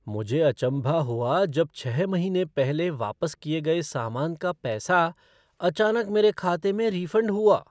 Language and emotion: Hindi, surprised